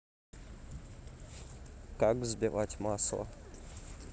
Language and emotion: Russian, neutral